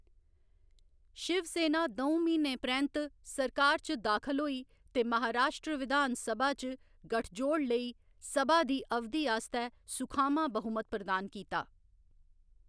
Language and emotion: Dogri, neutral